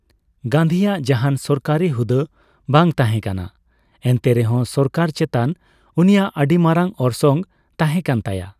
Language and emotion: Santali, neutral